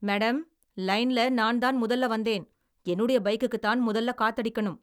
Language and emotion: Tamil, angry